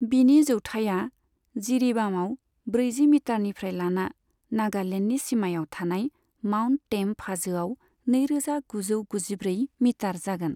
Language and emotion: Bodo, neutral